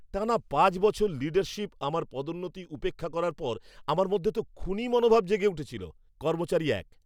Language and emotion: Bengali, angry